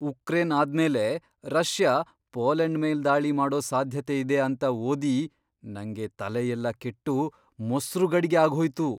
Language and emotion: Kannada, surprised